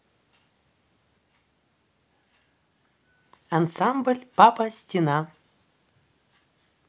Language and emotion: Russian, neutral